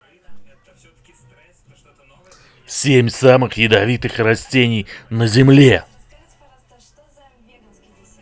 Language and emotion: Russian, angry